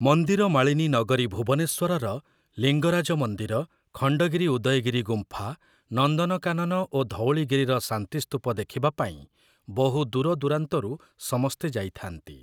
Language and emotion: Odia, neutral